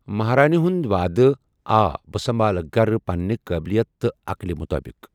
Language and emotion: Kashmiri, neutral